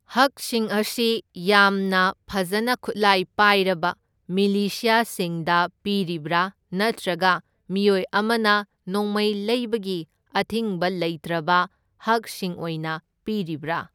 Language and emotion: Manipuri, neutral